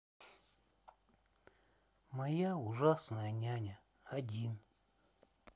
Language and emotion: Russian, sad